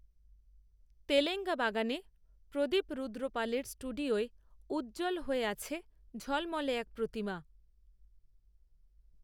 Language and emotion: Bengali, neutral